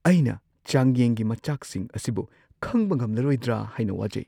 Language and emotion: Manipuri, fearful